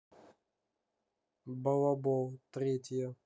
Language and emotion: Russian, neutral